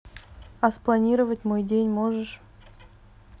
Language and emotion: Russian, neutral